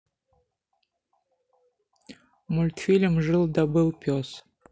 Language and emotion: Russian, neutral